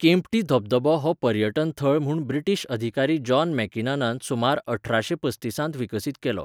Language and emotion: Goan Konkani, neutral